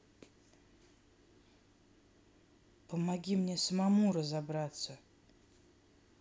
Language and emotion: Russian, neutral